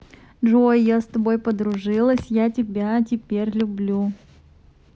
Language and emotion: Russian, positive